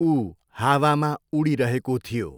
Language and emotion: Nepali, neutral